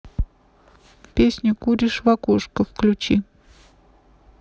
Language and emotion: Russian, neutral